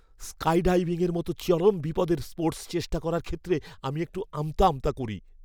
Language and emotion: Bengali, fearful